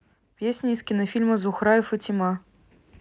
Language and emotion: Russian, neutral